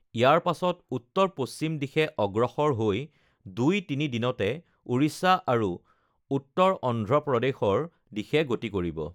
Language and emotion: Assamese, neutral